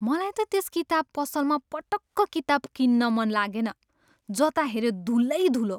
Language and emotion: Nepali, disgusted